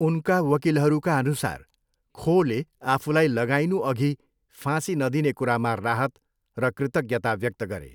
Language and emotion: Nepali, neutral